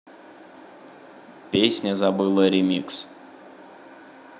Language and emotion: Russian, neutral